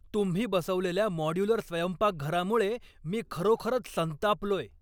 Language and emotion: Marathi, angry